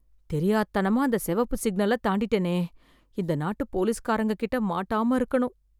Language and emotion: Tamil, fearful